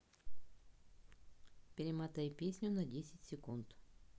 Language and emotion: Russian, neutral